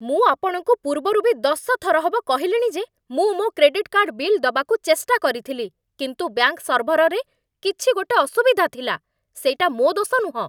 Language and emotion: Odia, angry